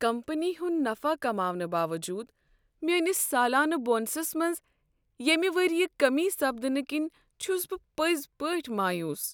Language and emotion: Kashmiri, sad